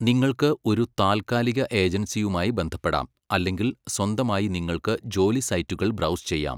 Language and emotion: Malayalam, neutral